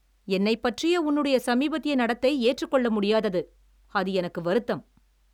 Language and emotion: Tamil, angry